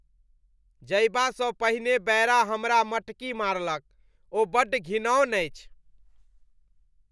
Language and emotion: Maithili, disgusted